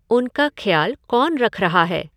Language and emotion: Hindi, neutral